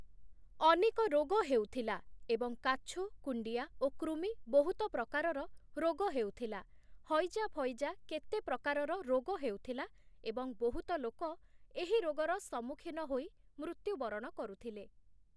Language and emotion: Odia, neutral